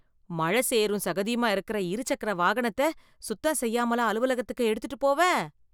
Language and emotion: Tamil, disgusted